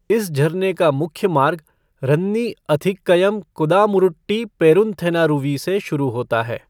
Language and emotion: Hindi, neutral